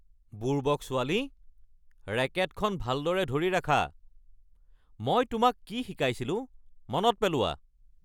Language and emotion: Assamese, angry